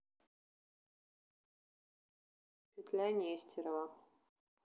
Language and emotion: Russian, neutral